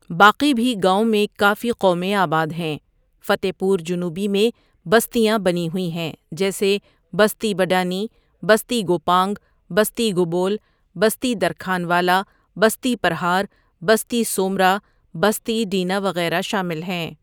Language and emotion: Urdu, neutral